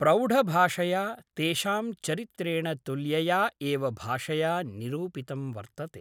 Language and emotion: Sanskrit, neutral